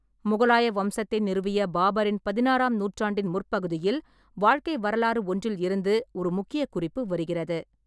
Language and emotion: Tamil, neutral